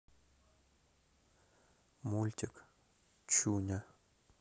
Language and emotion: Russian, neutral